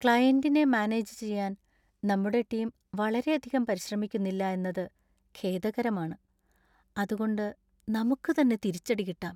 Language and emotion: Malayalam, sad